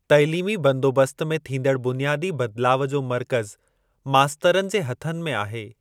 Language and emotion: Sindhi, neutral